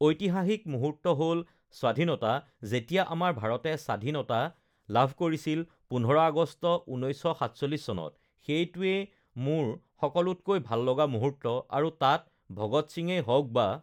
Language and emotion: Assamese, neutral